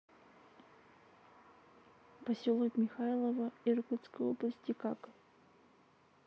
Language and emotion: Russian, neutral